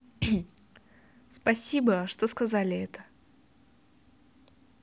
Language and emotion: Russian, positive